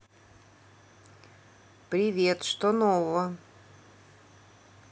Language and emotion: Russian, neutral